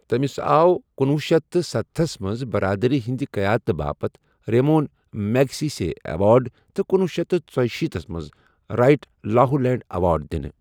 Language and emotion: Kashmiri, neutral